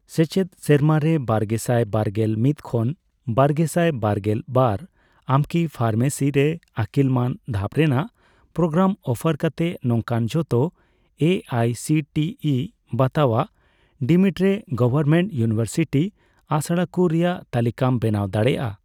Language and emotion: Santali, neutral